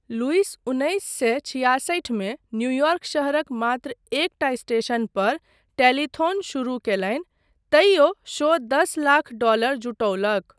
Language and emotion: Maithili, neutral